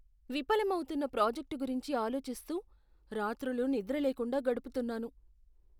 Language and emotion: Telugu, fearful